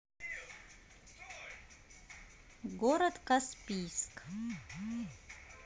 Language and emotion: Russian, neutral